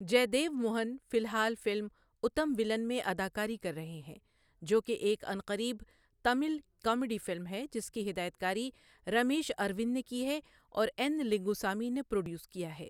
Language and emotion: Urdu, neutral